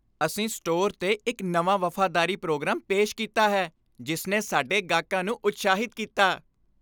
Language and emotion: Punjabi, happy